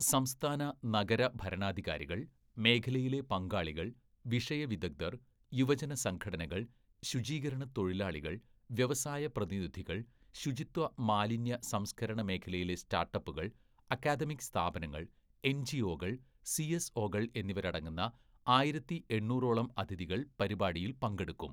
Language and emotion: Malayalam, neutral